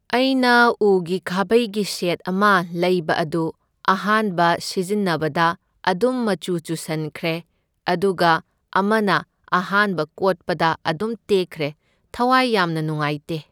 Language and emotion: Manipuri, neutral